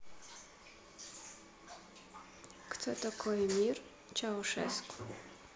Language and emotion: Russian, neutral